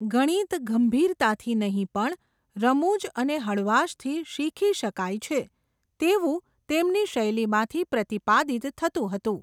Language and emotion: Gujarati, neutral